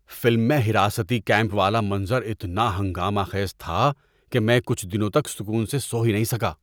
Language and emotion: Urdu, disgusted